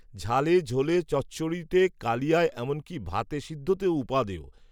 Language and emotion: Bengali, neutral